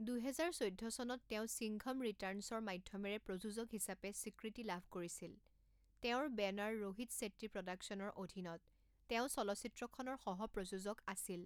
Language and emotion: Assamese, neutral